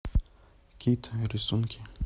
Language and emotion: Russian, neutral